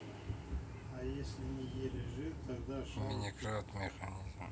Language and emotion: Russian, neutral